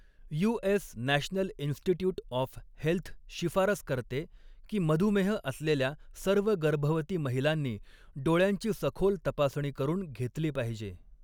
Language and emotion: Marathi, neutral